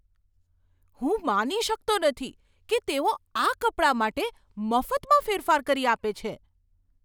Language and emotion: Gujarati, surprised